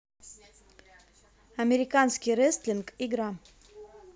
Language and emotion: Russian, neutral